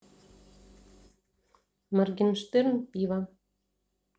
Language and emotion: Russian, neutral